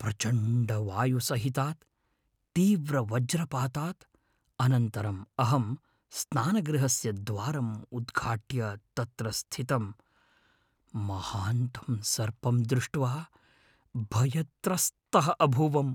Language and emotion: Sanskrit, fearful